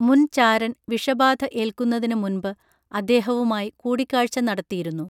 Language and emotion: Malayalam, neutral